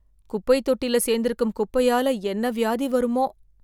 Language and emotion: Tamil, fearful